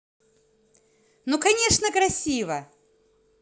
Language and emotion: Russian, positive